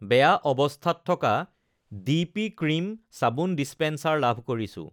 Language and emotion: Assamese, neutral